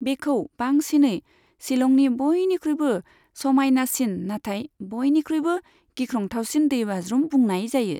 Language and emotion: Bodo, neutral